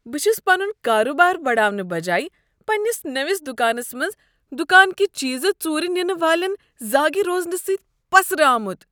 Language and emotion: Kashmiri, disgusted